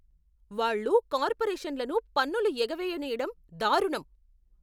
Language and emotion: Telugu, angry